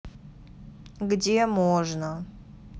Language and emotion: Russian, neutral